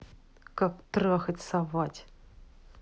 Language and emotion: Russian, angry